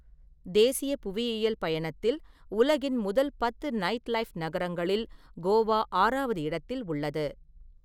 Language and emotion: Tamil, neutral